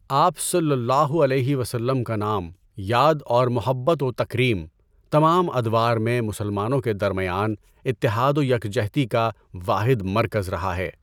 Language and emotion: Urdu, neutral